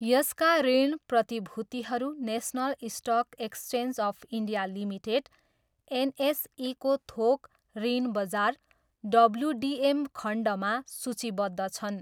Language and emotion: Nepali, neutral